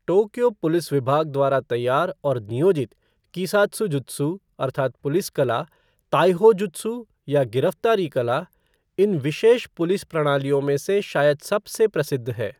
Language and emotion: Hindi, neutral